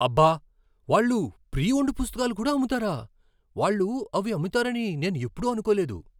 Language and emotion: Telugu, surprised